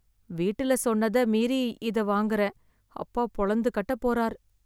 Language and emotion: Tamil, fearful